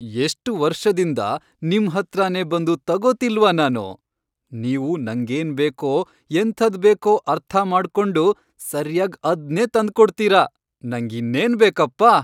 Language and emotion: Kannada, happy